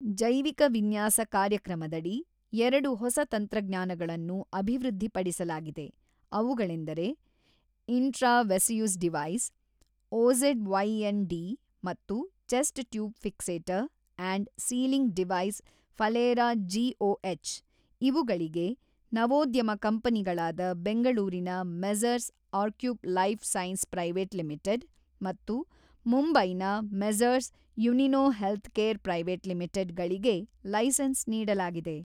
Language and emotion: Kannada, neutral